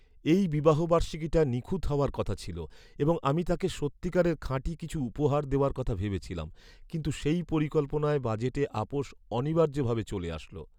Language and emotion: Bengali, sad